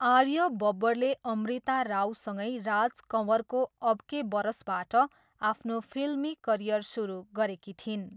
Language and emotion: Nepali, neutral